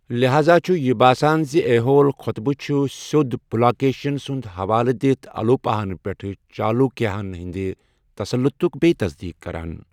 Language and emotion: Kashmiri, neutral